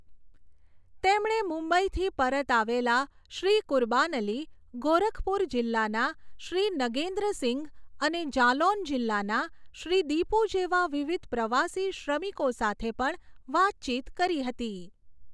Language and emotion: Gujarati, neutral